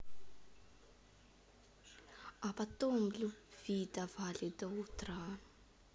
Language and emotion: Russian, neutral